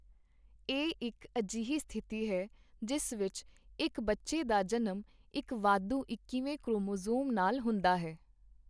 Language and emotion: Punjabi, neutral